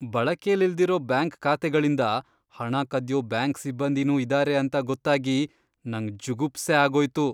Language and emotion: Kannada, disgusted